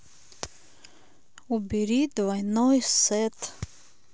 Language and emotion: Russian, neutral